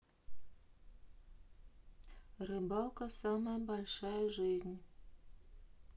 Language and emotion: Russian, neutral